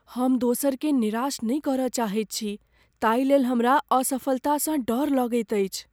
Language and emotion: Maithili, fearful